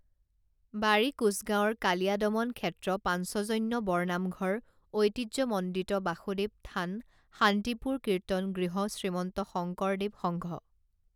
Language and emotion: Assamese, neutral